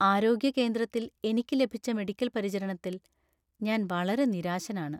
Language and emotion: Malayalam, sad